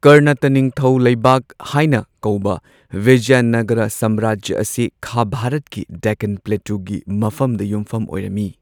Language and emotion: Manipuri, neutral